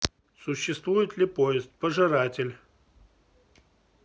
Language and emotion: Russian, neutral